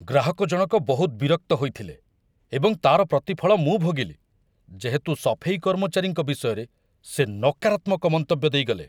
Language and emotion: Odia, angry